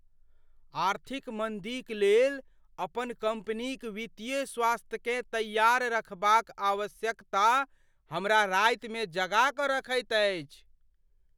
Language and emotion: Maithili, fearful